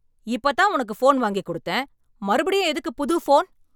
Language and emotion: Tamil, angry